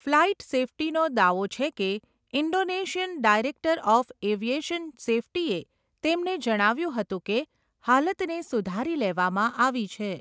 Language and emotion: Gujarati, neutral